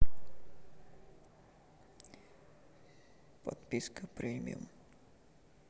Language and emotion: Russian, sad